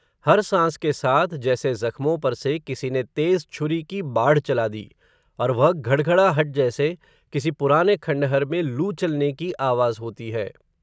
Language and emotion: Hindi, neutral